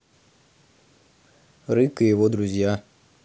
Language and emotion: Russian, neutral